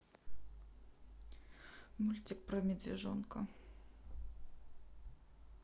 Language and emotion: Russian, neutral